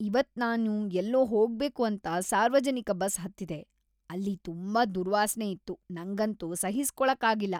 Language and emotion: Kannada, disgusted